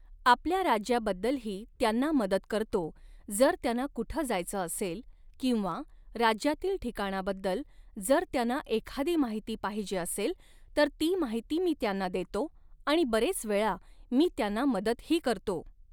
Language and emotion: Marathi, neutral